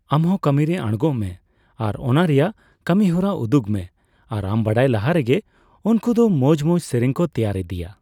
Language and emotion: Santali, neutral